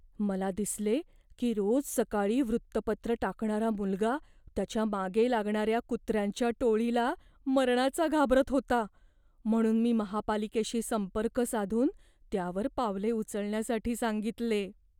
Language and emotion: Marathi, fearful